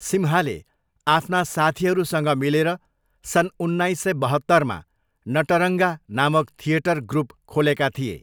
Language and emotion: Nepali, neutral